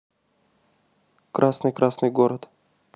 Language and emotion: Russian, neutral